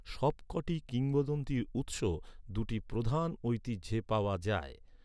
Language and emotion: Bengali, neutral